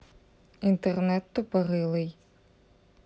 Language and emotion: Russian, neutral